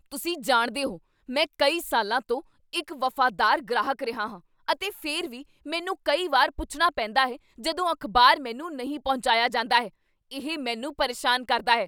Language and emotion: Punjabi, angry